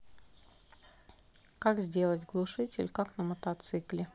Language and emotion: Russian, neutral